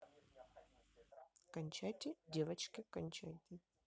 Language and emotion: Russian, neutral